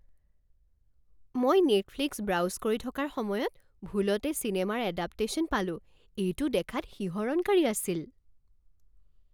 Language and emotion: Assamese, surprised